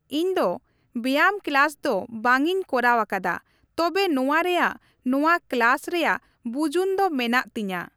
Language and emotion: Santali, neutral